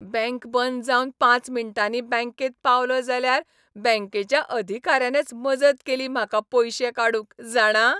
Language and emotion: Goan Konkani, happy